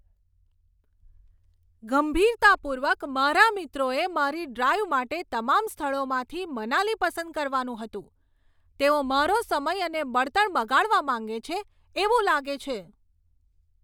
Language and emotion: Gujarati, angry